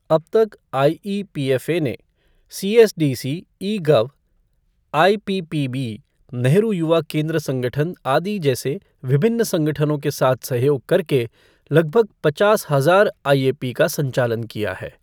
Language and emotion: Hindi, neutral